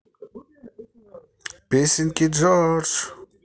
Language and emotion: Russian, positive